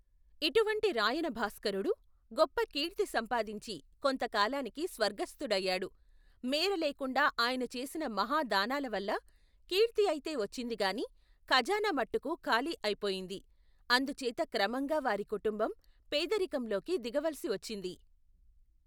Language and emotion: Telugu, neutral